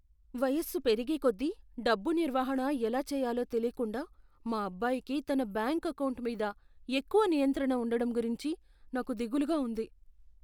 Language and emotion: Telugu, fearful